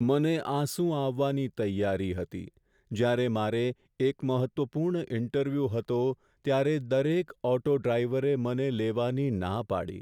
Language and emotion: Gujarati, sad